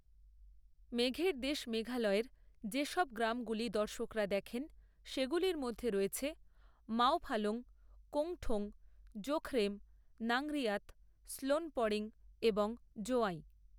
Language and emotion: Bengali, neutral